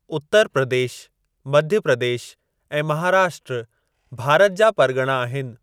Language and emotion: Sindhi, neutral